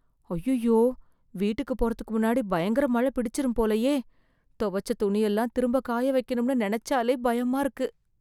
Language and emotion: Tamil, fearful